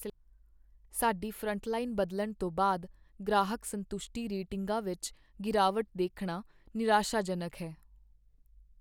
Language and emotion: Punjabi, sad